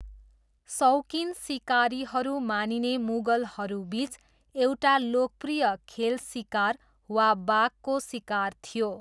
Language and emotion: Nepali, neutral